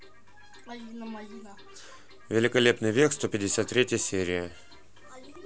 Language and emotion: Russian, neutral